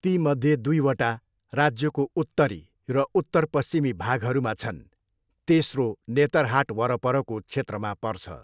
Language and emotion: Nepali, neutral